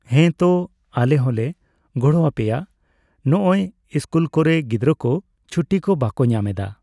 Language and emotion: Santali, neutral